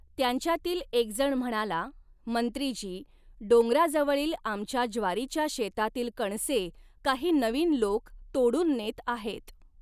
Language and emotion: Marathi, neutral